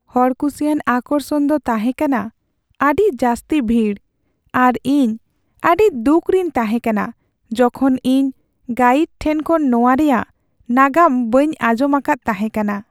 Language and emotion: Santali, sad